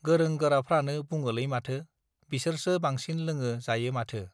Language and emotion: Bodo, neutral